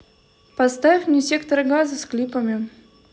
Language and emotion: Russian, neutral